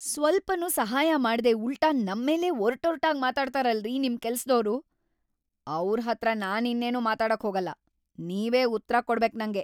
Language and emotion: Kannada, angry